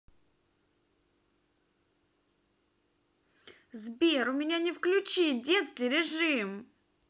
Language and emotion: Russian, angry